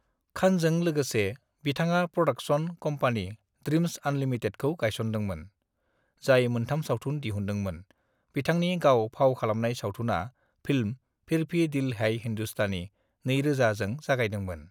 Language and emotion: Bodo, neutral